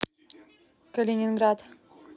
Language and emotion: Russian, neutral